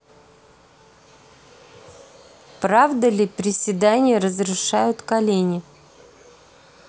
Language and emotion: Russian, neutral